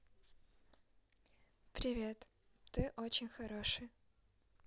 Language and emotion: Russian, neutral